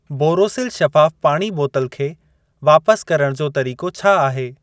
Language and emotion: Sindhi, neutral